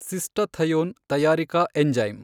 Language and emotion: Kannada, neutral